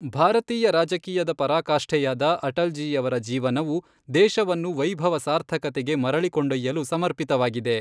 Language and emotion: Kannada, neutral